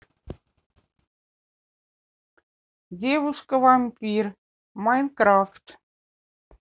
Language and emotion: Russian, neutral